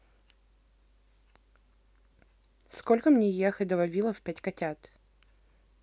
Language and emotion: Russian, neutral